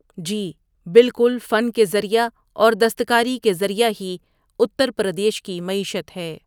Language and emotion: Urdu, neutral